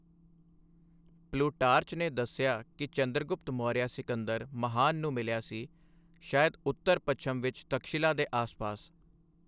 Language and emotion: Punjabi, neutral